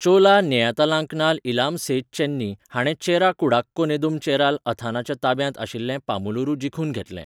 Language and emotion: Goan Konkani, neutral